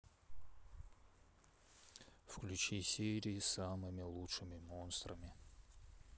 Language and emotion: Russian, neutral